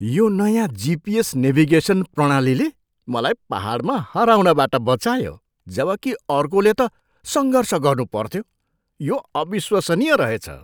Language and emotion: Nepali, surprised